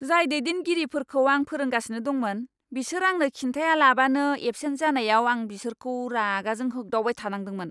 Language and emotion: Bodo, angry